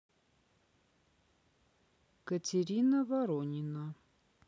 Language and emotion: Russian, neutral